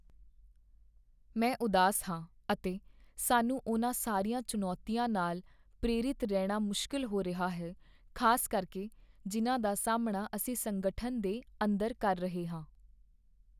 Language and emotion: Punjabi, sad